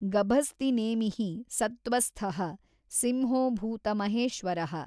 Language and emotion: Kannada, neutral